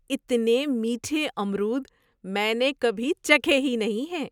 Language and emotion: Urdu, surprised